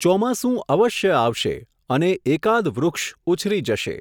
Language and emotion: Gujarati, neutral